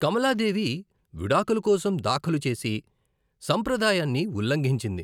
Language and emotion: Telugu, neutral